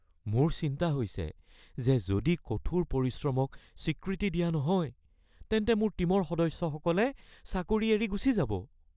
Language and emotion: Assamese, fearful